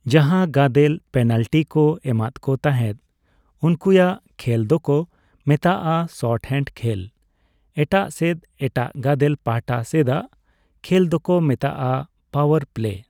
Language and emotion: Santali, neutral